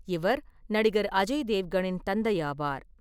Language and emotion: Tamil, neutral